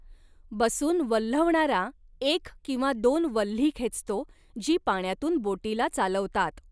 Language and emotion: Marathi, neutral